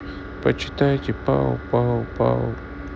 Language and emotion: Russian, sad